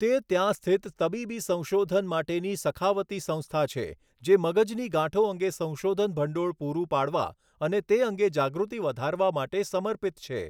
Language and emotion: Gujarati, neutral